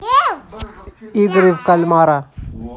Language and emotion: Russian, neutral